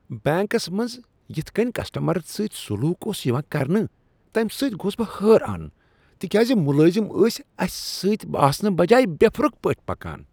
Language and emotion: Kashmiri, disgusted